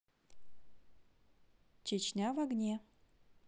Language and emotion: Russian, neutral